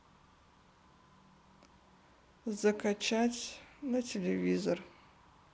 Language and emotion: Russian, sad